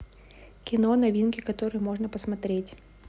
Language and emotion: Russian, neutral